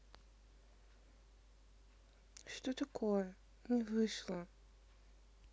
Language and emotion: Russian, sad